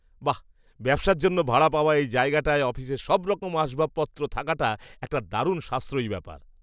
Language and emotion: Bengali, surprised